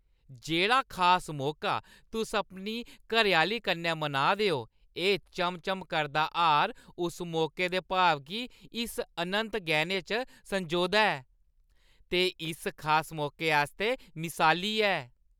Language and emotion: Dogri, happy